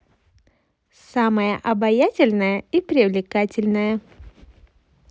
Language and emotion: Russian, positive